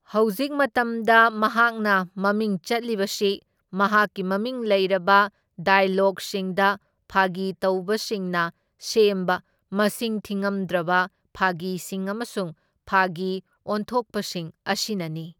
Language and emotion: Manipuri, neutral